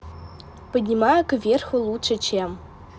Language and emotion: Russian, neutral